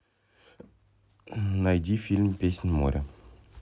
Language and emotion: Russian, neutral